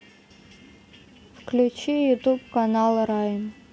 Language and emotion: Russian, neutral